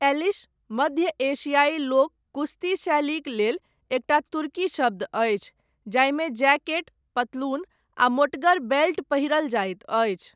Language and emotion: Maithili, neutral